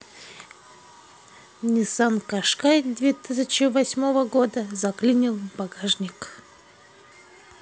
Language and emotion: Russian, neutral